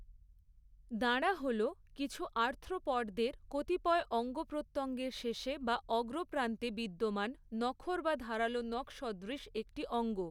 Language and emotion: Bengali, neutral